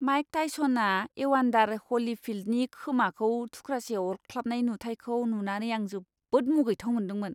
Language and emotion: Bodo, disgusted